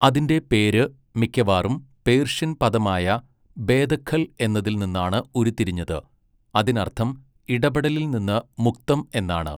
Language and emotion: Malayalam, neutral